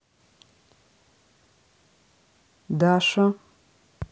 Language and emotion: Russian, neutral